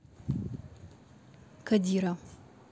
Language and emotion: Russian, neutral